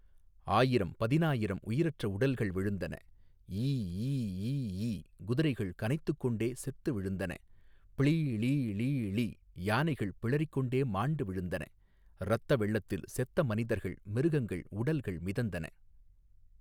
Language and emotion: Tamil, neutral